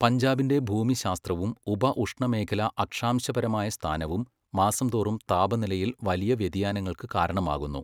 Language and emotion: Malayalam, neutral